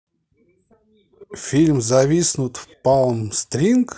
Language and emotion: Russian, positive